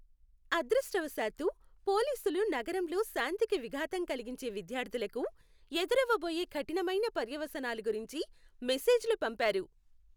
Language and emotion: Telugu, happy